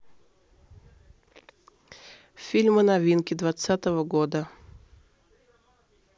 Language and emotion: Russian, neutral